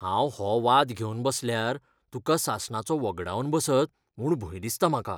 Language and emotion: Goan Konkani, fearful